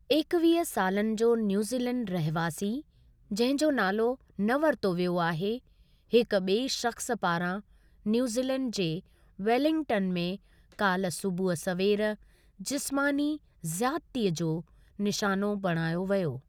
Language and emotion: Sindhi, neutral